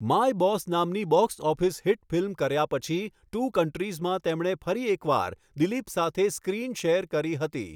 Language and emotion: Gujarati, neutral